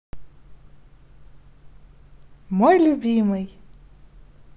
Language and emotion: Russian, positive